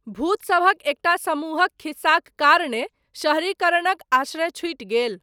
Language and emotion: Maithili, neutral